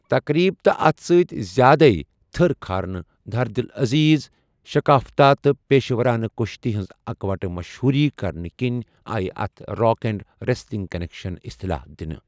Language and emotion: Kashmiri, neutral